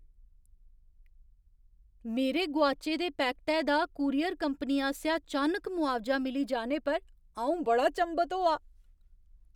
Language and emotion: Dogri, surprised